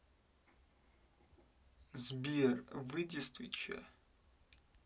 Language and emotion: Russian, angry